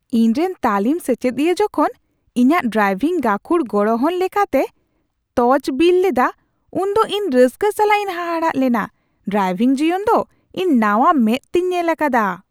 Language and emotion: Santali, surprised